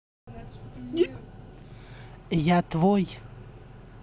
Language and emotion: Russian, neutral